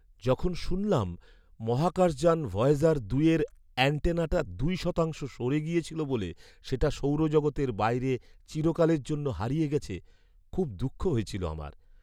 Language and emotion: Bengali, sad